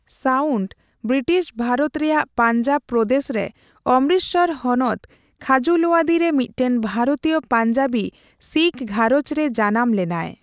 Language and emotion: Santali, neutral